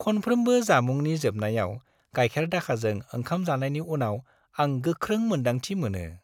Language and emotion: Bodo, happy